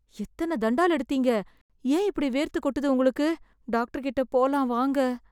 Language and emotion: Tamil, fearful